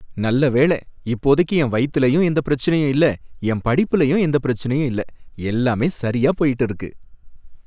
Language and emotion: Tamil, happy